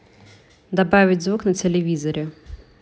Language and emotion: Russian, neutral